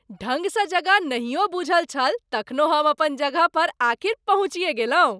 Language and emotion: Maithili, happy